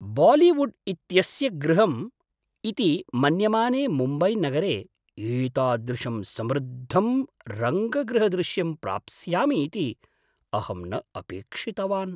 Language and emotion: Sanskrit, surprised